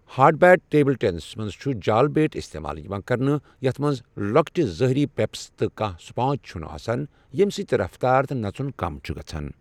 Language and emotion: Kashmiri, neutral